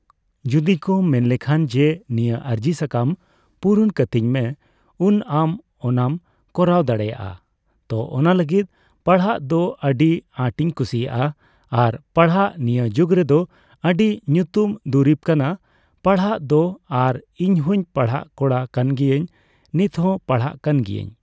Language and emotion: Santali, neutral